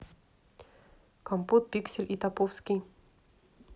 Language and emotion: Russian, neutral